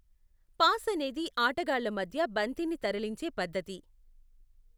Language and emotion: Telugu, neutral